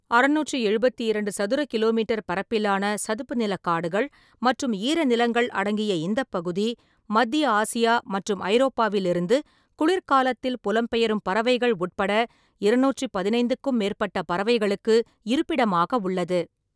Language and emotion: Tamil, neutral